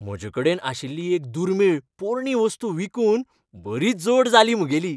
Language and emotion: Goan Konkani, happy